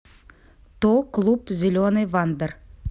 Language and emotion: Russian, neutral